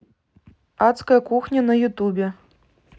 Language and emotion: Russian, neutral